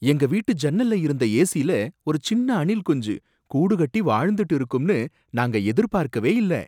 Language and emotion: Tamil, surprised